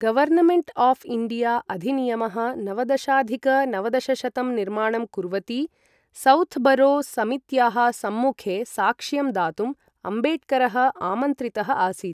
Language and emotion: Sanskrit, neutral